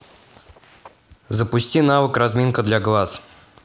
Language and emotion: Russian, neutral